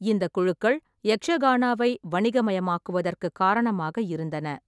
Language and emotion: Tamil, neutral